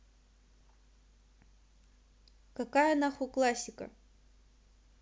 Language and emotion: Russian, neutral